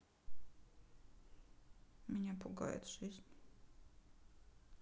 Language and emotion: Russian, sad